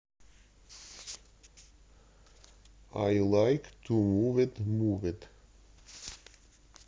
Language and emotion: Russian, neutral